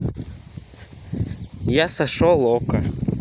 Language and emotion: Russian, neutral